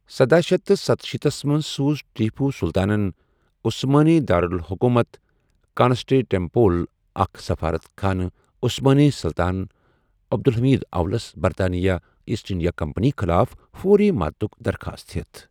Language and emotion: Kashmiri, neutral